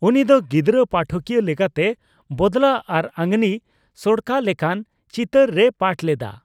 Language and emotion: Santali, neutral